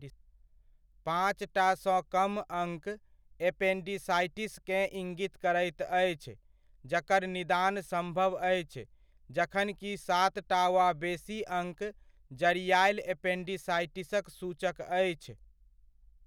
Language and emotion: Maithili, neutral